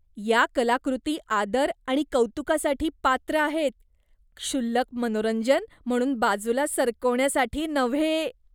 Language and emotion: Marathi, disgusted